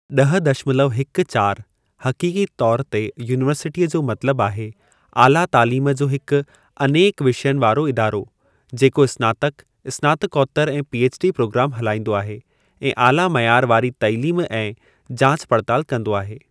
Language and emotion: Sindhi, neutral